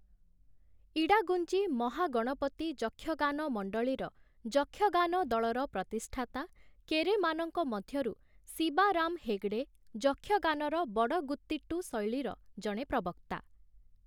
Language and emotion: Odia, neutral